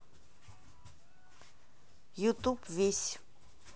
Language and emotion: Russian, neutral